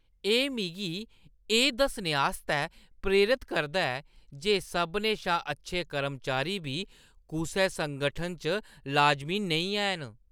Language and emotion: Dogri, disgusted